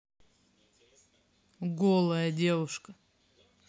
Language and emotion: Russian, neutral